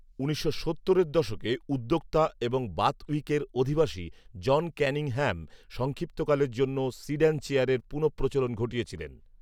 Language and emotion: Bengali, neutral